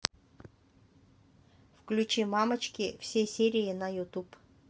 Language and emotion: Russian, neutral